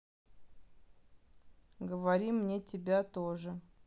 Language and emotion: Russian, neutral